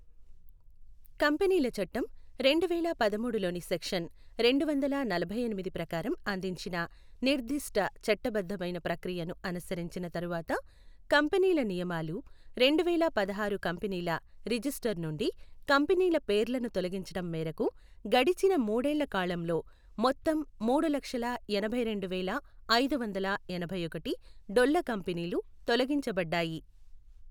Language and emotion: Telugu, neutral